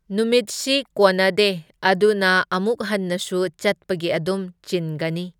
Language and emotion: Manipuri, neutral